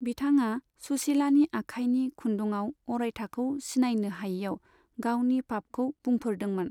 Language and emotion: Bodo, neutral